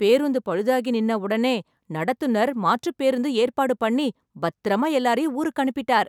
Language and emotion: Tamil, happy